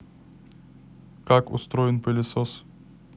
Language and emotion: Russian, neutral